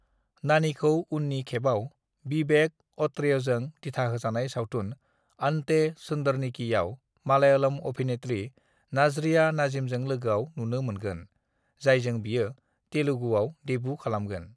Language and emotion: Bodo, neutral